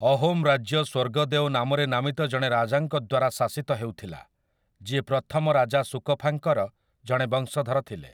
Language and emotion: Odia, neutral